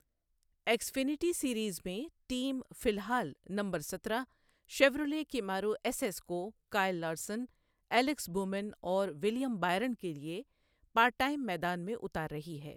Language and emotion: Urdu, neutral